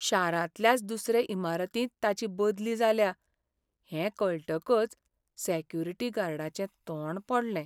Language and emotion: Goan Konkani, sad